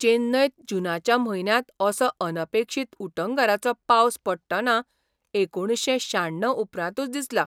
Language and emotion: Goan Konkani, surprised